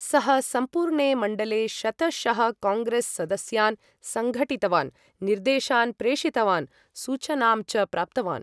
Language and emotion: Sanskrit, neutral